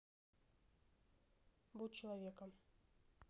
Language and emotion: Russian, neutral